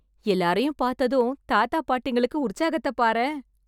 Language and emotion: Tamil, happy